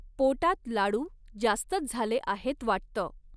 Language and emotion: Marathi, neutral